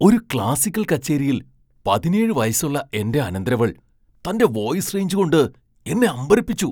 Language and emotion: Malayalam, surprised